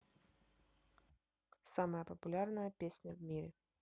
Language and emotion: Russian, neutral